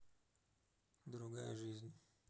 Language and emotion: Russian, neutral